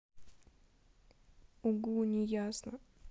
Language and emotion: Russian, neutral